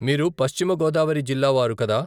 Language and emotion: Telugu, neutral